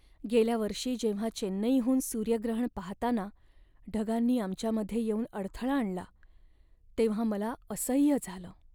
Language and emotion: Marathi, sad